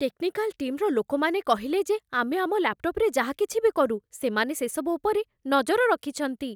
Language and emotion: Odia, fearful